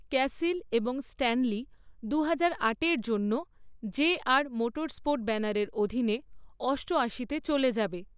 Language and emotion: Bengali, neutral